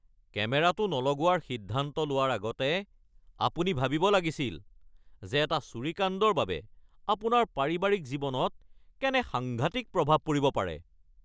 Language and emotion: Assamese, angry